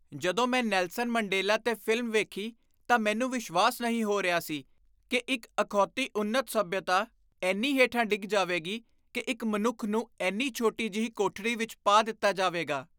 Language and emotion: Punjabi, disgusted